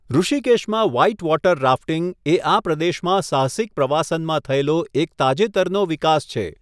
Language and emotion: Gujarati, neutral